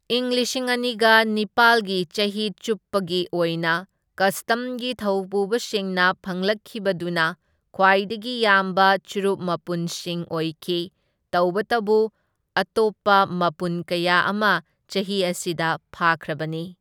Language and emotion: Manipuri, neutral